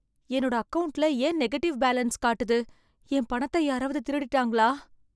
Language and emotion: Tamil, fearful